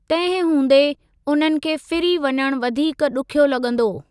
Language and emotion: Sindhi, neutral